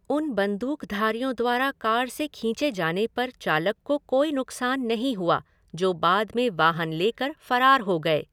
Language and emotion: Hindi, neutral